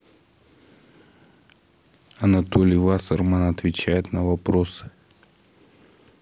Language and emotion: Russian, neutral